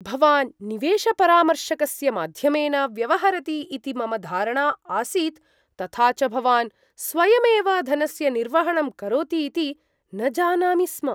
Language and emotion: Sanskrit, surprised